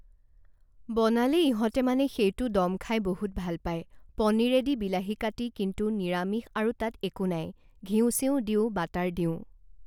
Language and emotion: Assamese, neutral